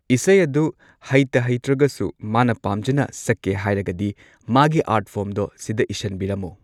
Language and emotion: Manipuri, neutral